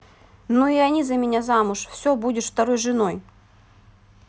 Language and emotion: Russian, neutral